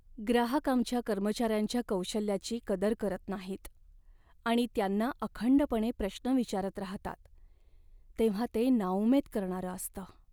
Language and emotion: Marathi, sad